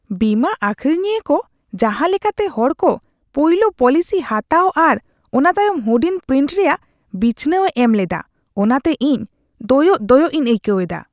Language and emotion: Santali, disgusted